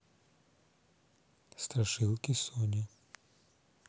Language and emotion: Russian, neutral